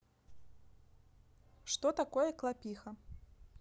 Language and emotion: Russian, neutral